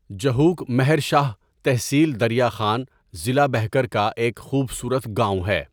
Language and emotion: Urdu, neutral